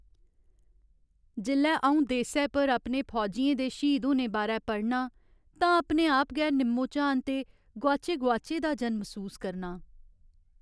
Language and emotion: Dogri, sad